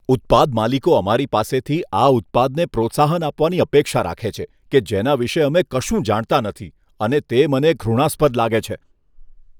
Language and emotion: Gujarati, disgusted